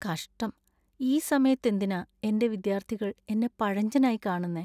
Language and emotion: Malayalam, sad